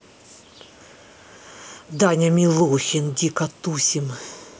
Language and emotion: Russian, angry